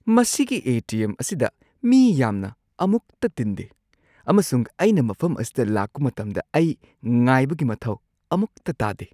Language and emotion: Manipuri, surprised